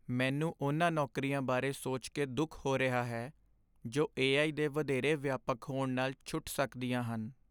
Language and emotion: Punjabi, sad